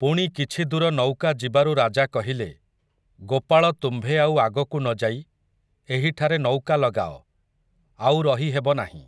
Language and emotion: Odia, neutral